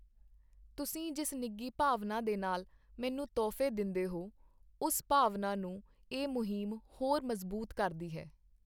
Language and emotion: Punjabi, neutral